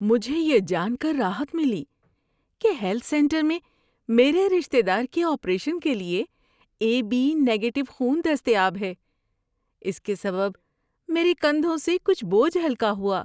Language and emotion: Urdu, happy